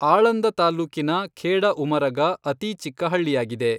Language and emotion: Kannada, neutral